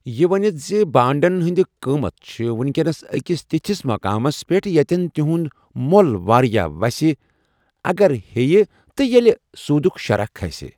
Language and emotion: Kashmiri, neutral